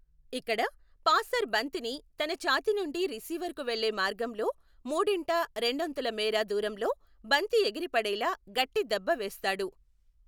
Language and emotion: Telugu, neutral